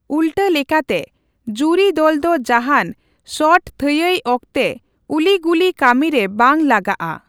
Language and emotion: Santali, neutral